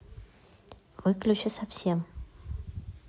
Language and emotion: Russian, neutral